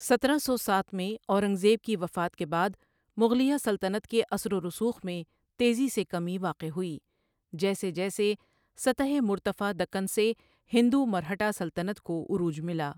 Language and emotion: Urdu, neutral